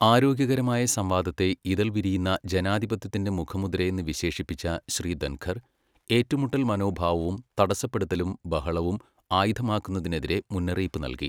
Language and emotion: Malayalam, neutral